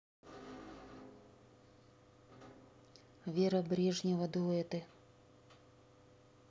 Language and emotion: Russian, neutral